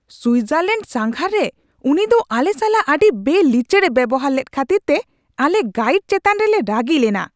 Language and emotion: Santali, angry